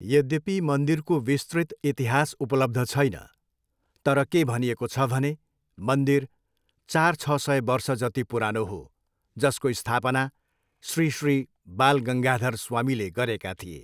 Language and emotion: Nepali, neutral